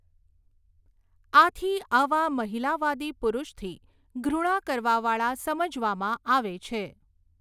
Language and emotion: Gujarati, neutral